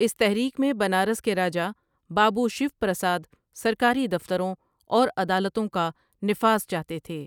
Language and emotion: Urdu, neutral